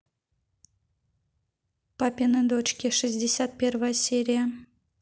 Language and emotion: Russian, neutral